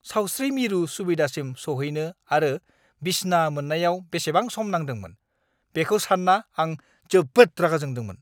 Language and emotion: Bodo, angry